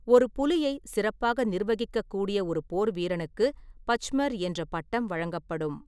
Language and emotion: Tamil, neutral